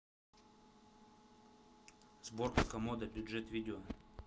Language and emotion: Russian, neutral